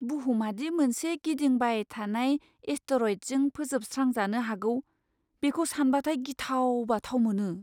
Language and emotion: Bodo, fearful